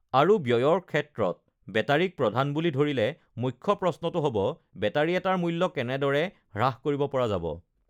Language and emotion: Assamese, neutral